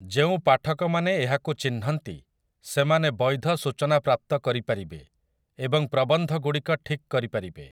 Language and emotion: Odia, neutral